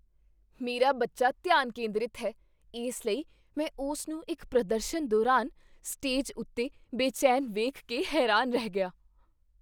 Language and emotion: Punjabi, surprised